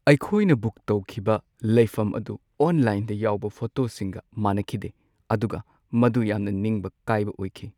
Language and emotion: Manipuri, sad